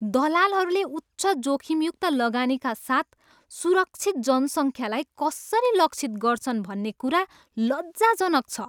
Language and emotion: Nepali, disgusted